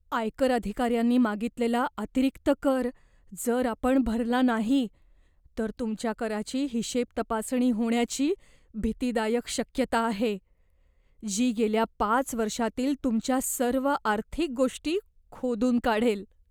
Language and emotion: Marathi, fearful